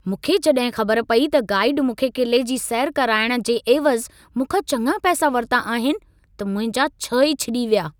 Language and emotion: Sindhi, angry